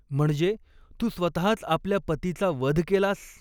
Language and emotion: Marathi, neutral